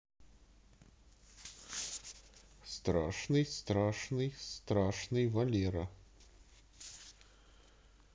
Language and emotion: Russian, positive